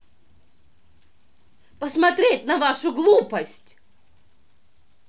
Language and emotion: Russian, angry